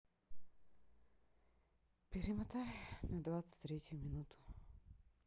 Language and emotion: Russian, sad